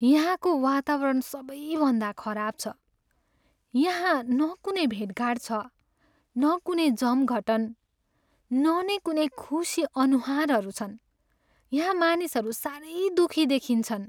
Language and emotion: Nepali, sad